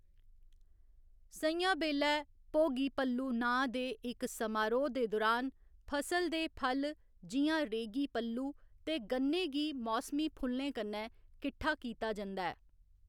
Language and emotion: Dogri, neutral